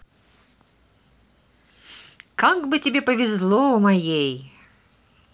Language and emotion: Russian, positive